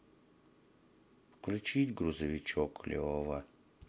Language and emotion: Russian, sad